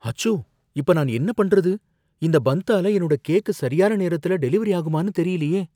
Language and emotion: Tamil, fearful